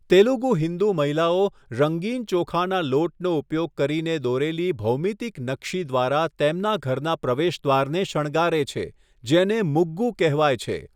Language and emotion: Gujarati, neutral